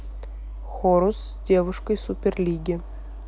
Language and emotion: Russian, neutral